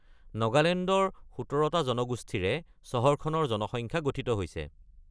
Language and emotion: Assamese, neutral